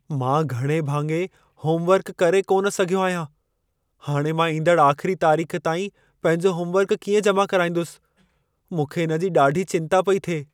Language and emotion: Sindhi, fearful